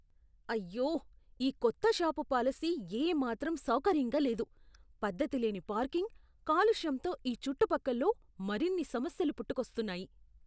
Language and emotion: Telugu, disgusted